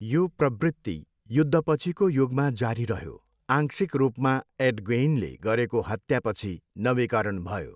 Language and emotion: Nepali, neutral